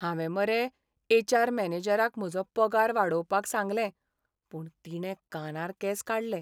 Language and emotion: Goan Konkani, sad